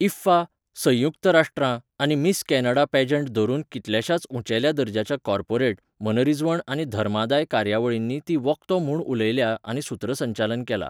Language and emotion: Goan Konkani, neutral